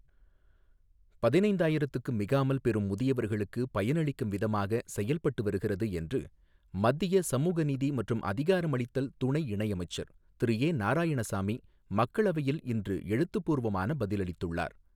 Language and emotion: Tamil, neutral